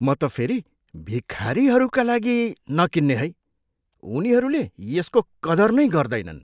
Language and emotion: Nepali, disgusted